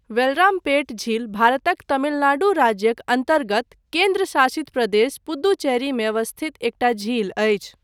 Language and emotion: Maithili, neutral